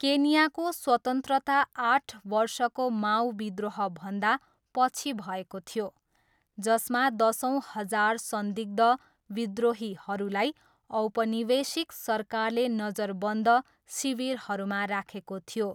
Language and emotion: Nepali, neutral